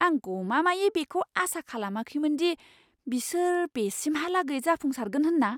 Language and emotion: Bodo, surprised